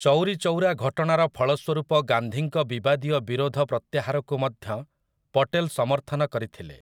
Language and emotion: Odia, neutral